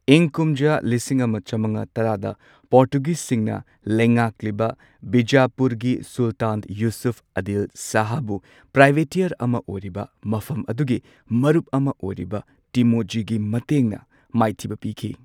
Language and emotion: Manipuri, neutral